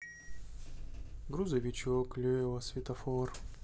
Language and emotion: Russian, sad